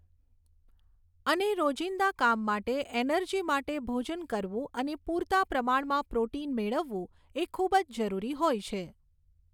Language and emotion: Gujarati, neutral